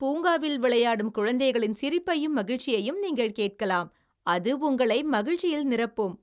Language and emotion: Tamil, happy